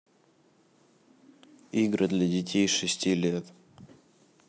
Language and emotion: Russian, neutral